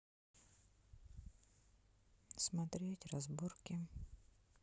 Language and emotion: Russian, neutral